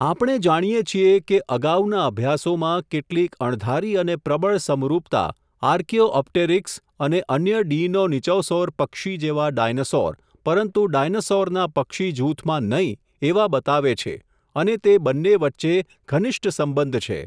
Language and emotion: Gujarati, neutral